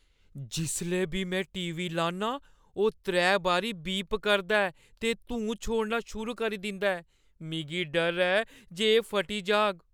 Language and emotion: Dogri, fearful